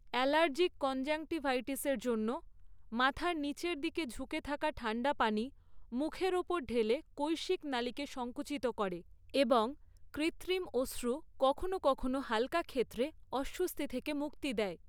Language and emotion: Bengali, neutral